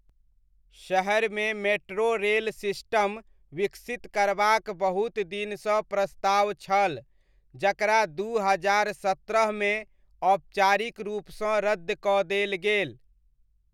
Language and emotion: Maithili, neutral